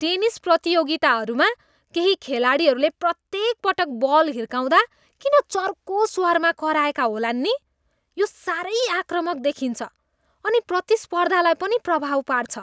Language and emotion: Nepali, disgusted